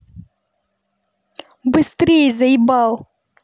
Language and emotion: Russian, angry